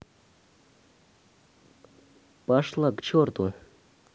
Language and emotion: Russian, angry